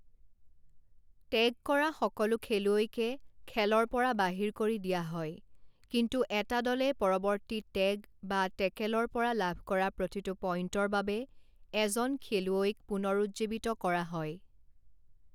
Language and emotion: Assamese, neutral